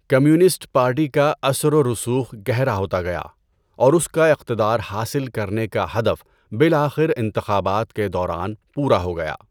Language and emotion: Urdu, neutral